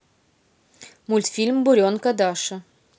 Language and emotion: Russian, neutral